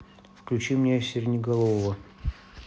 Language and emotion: Russian, neutral